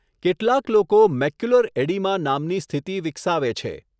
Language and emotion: Gujarati, neutral